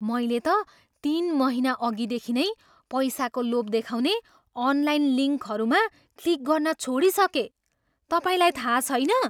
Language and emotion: Nepali, surprised